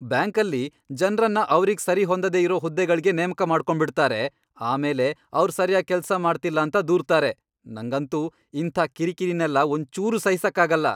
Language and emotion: Kannada, angry